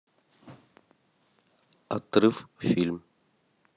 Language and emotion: Russian, neutral